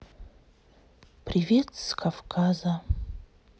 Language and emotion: Russian, sad